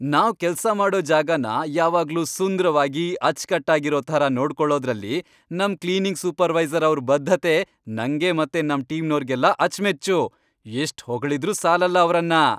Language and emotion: Kannada, happy